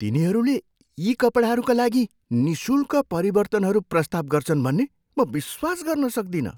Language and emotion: Nepali, surprised